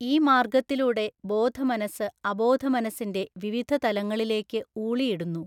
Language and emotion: Malayalam, neutral